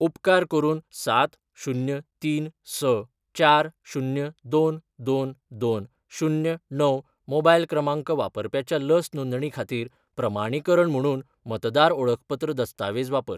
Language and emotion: Goan Konkani, neutral